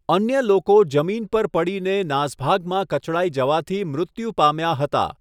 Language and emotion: Gujarati, neutral